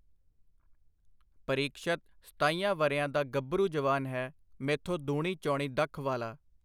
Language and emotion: Punjabi, neutral